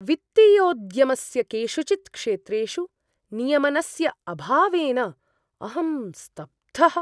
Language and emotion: Sanskrit, surprised